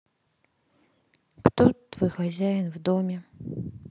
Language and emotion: Russian, sad